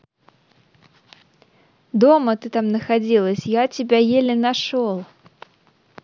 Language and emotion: Russian, neutral